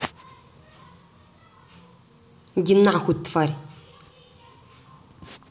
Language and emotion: Russian, angry